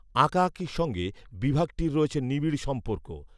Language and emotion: Bengali, neutral